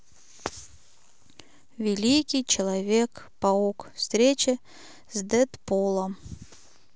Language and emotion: Russian, neutral